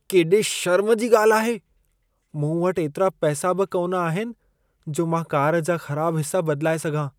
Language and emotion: Sindhi, disgusted